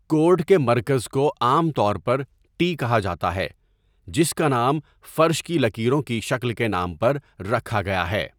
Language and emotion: Urdu, neutral